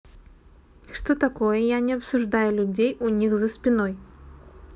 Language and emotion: Russian, neutral